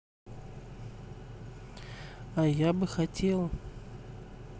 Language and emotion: Russian, neutral